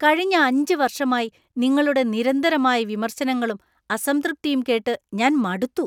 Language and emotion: Malayalam, disgusted